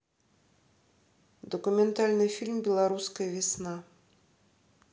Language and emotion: Russian, neutral